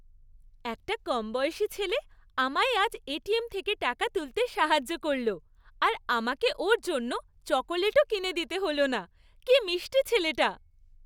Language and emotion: Bengali, happy